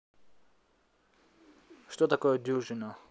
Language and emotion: Russian, neutral